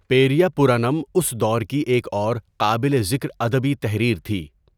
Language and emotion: Urdu, neutral